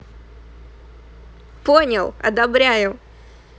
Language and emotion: Russian, positive